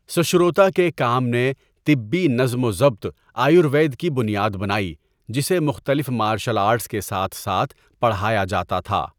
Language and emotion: Urdu, neutral